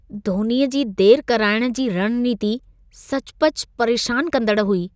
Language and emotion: Sindhi, disgusted